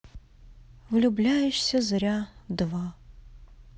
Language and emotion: Russian, sad